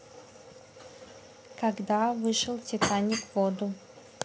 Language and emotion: Russian, neutral